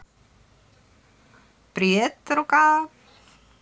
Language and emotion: Russian, positive